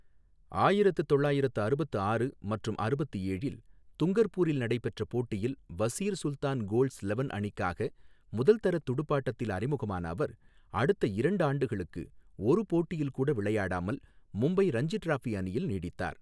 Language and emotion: Tamil, neutral